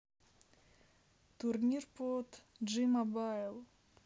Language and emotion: Russian, neutral